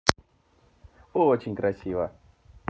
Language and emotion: Russian, positive